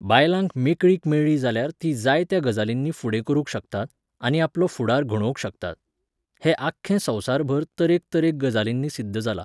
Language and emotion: Goan Konkani, neutral